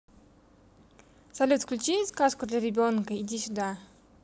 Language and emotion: Russian, neutral